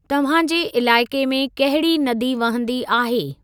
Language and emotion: Sindhi, neutral